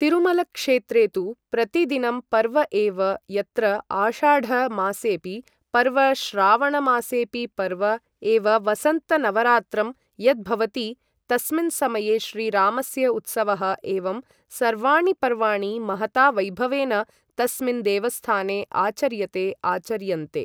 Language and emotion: Sanskrit, neutral